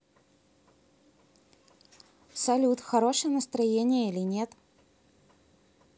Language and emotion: Russian, neutral